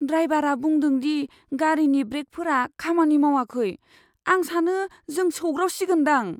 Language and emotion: Bodo, fearful